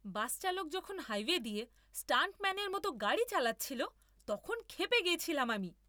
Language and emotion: Bengali, angry